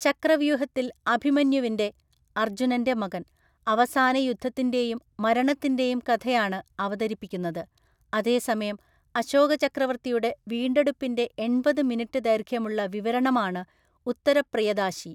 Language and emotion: Malayalam, neutral